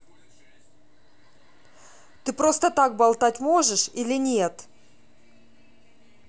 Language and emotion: Russian, angry